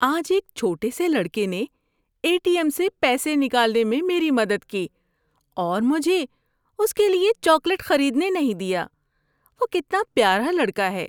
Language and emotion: Urdu, happy